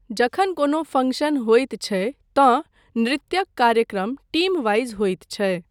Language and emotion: Maithili, neutral